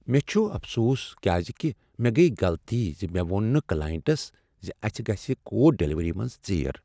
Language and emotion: Kashmiri, sad